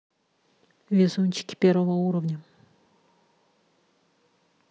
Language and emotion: Russian, neutral